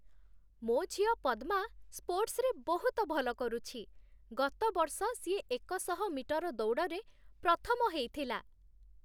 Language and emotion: Odia, happy